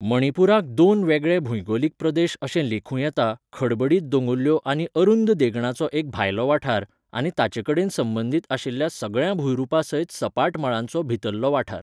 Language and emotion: Goan Konkani, neutral